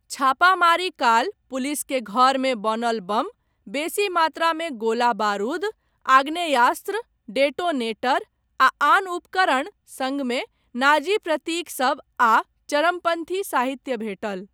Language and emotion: Maithili, neutral